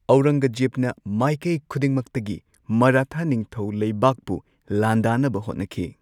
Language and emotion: Manipuri, neutral